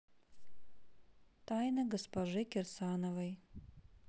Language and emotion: Russian, neutral